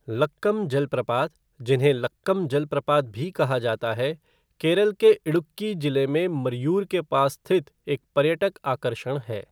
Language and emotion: Hindi, neutral